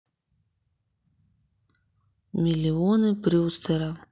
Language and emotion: Russian, neutral